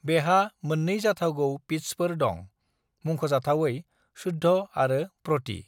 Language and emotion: Bodo, neutral